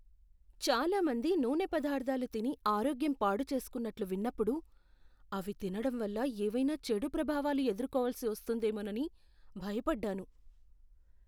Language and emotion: Telugu, fearful